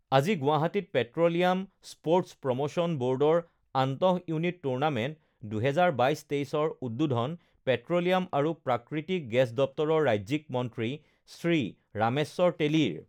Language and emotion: Assamese, neutral